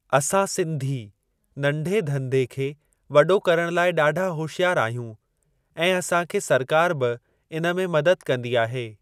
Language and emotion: Sindhi, neutral